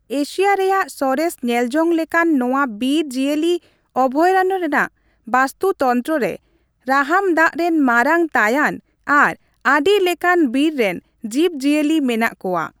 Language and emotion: Santali, neutral